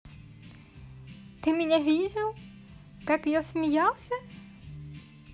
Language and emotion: Russian, positive